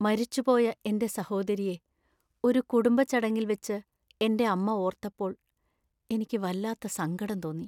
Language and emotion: Malayalam, sad